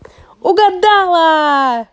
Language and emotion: Russian, positive